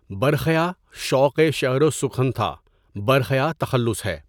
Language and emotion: Urdu, neutral